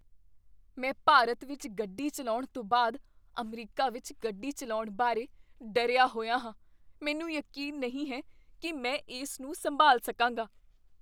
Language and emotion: Punjabi, fearful